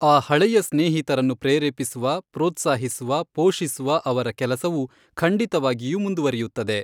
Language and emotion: Kannada, neutral